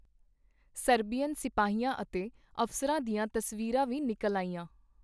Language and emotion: Punjabi, neutral